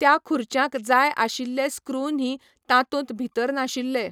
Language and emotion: Goan Konkani, neutral